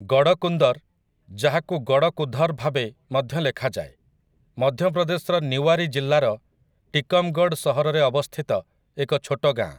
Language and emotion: Odia, neutral